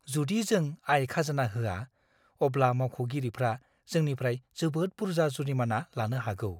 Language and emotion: Bodo, fearful